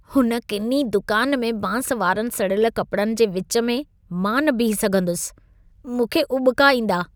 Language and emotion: Sindhi, disgusted